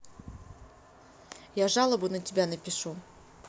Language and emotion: Russian, angry